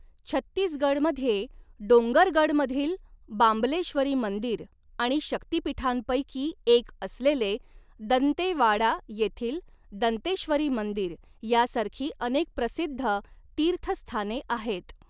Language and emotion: Marathi, neutral